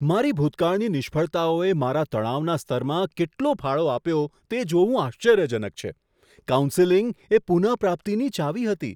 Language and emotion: Gujarati, surprised